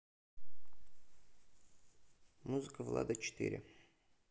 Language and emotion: Russian, neutral